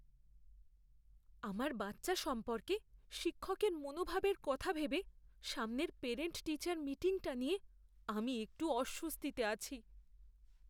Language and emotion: Bengali, fearful